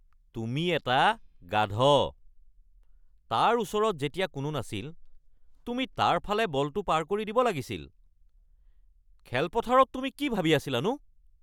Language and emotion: Assamese, angry